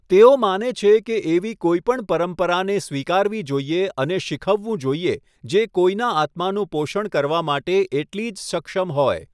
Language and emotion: Gujarati, neutral